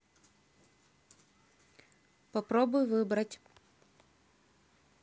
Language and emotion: Russian, neutral